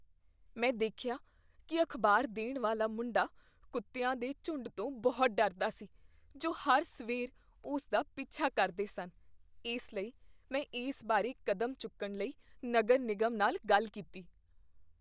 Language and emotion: Punjabi, fearful